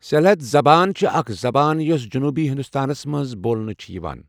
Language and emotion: Kashmiri, neutral